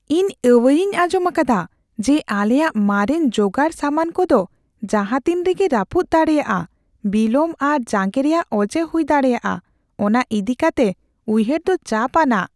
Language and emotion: Santali, fearful